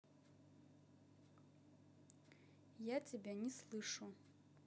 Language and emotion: Russian, neutral